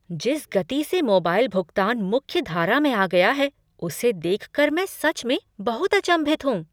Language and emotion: Hindi, surprised